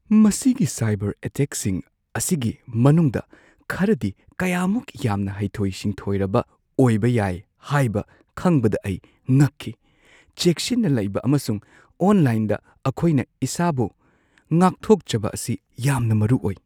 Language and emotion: Manipuri, surprised